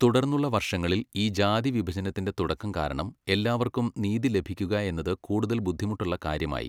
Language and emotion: Malayalam, neutral